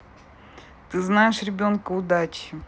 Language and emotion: Russian, neutral